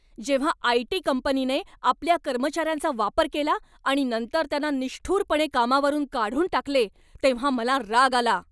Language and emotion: Marathi, angry